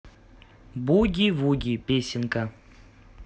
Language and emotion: Russian, positive